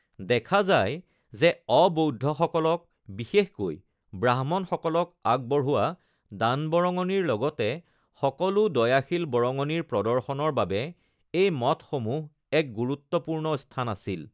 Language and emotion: Assamese, neutral